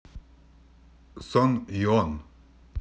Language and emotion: Russian, neutral